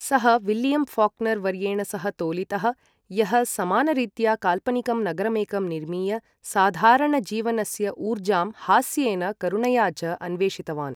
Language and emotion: Sanskrit, neutral